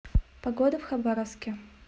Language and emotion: Russian, neutral